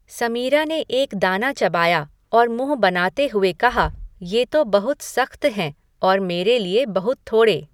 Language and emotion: Hindi, neutral